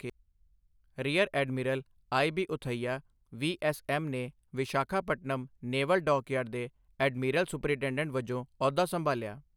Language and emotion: Punjabi, neutral